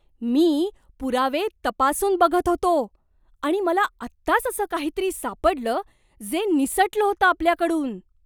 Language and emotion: Marathi, surprised